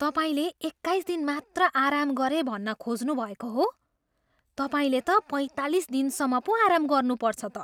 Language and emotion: Nepali, surprised